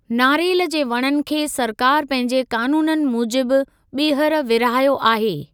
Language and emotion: Sindhi, neutral